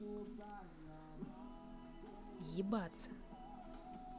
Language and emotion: Russian, angry